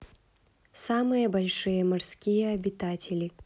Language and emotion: Russian, neutral